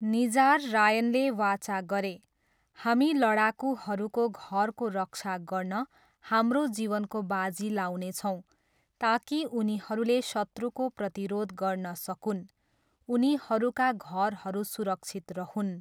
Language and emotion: Nepali, neutral